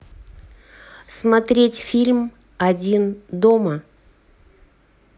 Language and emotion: Russian, neutral